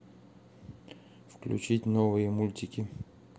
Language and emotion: Russian, neutral